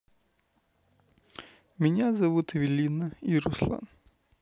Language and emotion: Russian, neutral